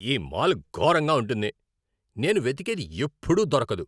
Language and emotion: Telugu, angry